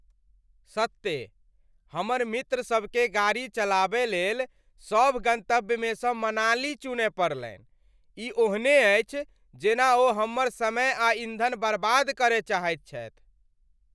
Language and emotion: Maithili, angry